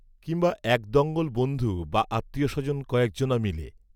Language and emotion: Bengali, neutral